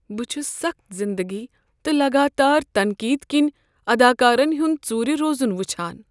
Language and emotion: Kashmiri, sad